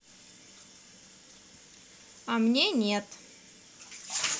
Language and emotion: Russian, neutral